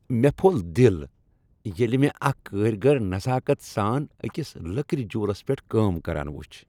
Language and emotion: Kashmiri, happy